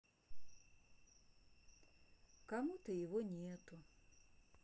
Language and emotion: Russian, sad